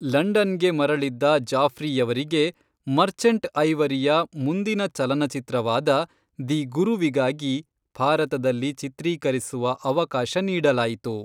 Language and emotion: Kannada, neutral